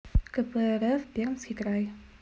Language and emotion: Russian, neutral